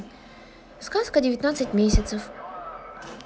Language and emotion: Russian, neutral